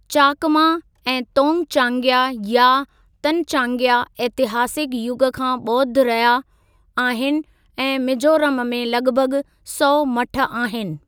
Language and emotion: Sindhi, neutral